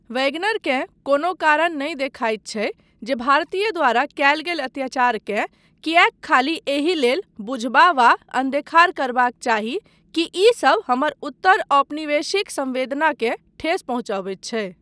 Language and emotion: Maithili, neutral